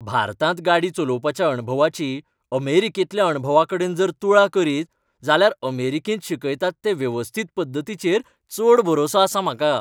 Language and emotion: Goan Konkani, happy